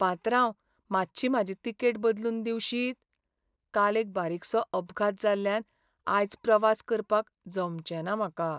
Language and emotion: Goan Konkani, sad